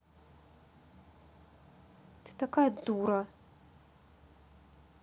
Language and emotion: Russian, angry